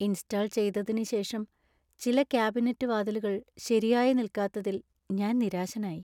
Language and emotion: Malayalam, sad